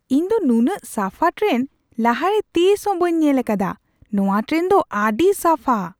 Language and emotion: Santali, surprised